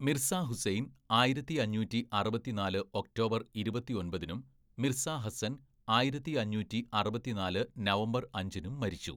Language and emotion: Malayalam, neutral